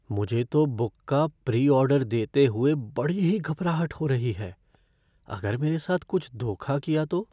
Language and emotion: Hindi, fearful